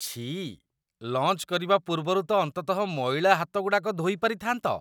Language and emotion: Odia, disgusted